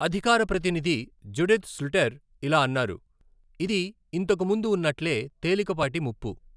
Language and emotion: Telugu, neutral